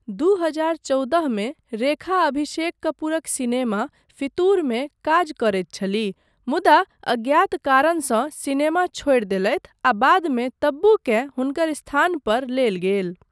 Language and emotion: Maithili, neutral